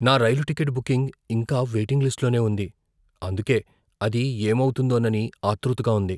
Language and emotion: Telugu, fearful